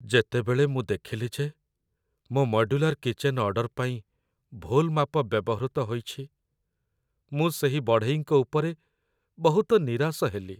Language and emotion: Odia, sad